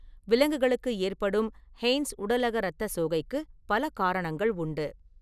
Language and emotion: Tamil, neutral